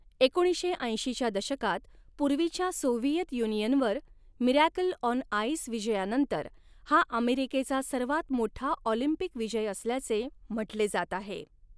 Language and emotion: Marathi, neutral